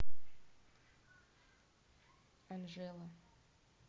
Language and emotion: Russian, neutral